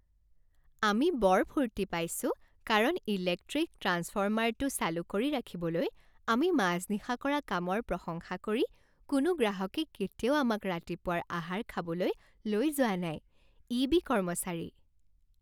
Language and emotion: Assamese, happy